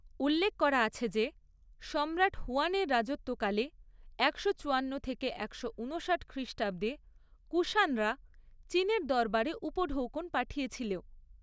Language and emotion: Bengali, neutral